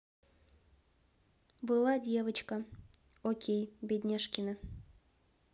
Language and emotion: Russian, neutral